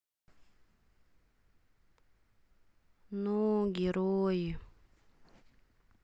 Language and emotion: Russian, sad